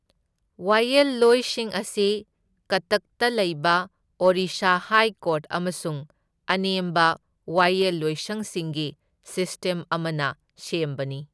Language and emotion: Manipuri, neutral